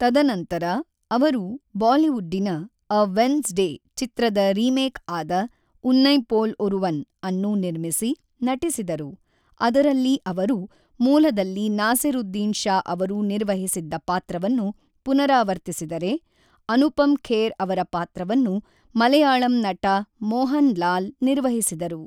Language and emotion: Kannada, neutral